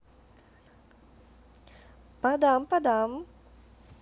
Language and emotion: Russian, positive